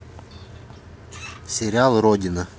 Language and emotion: Russian, neutral